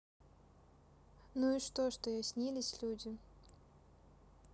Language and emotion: Russian, neutral